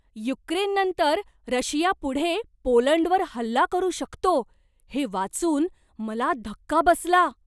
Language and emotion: Marathi, surprised